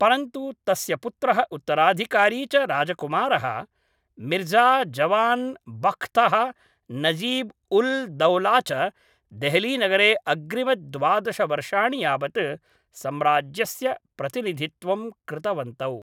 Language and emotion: Sanskrit, neutral